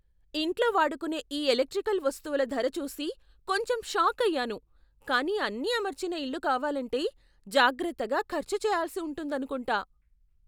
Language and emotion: Telugu, surprised